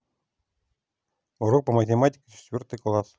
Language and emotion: Russian, neutral